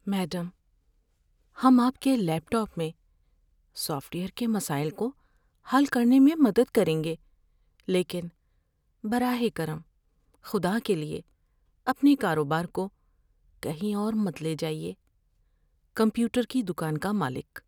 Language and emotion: Urdu, fearful